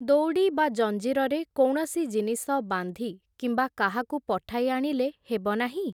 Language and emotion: Odia, neutral